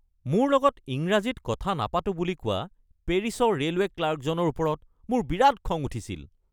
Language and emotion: Assamese, angry